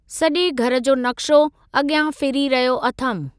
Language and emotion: Sindhi, neutral